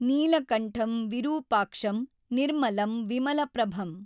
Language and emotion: Kannada, neutral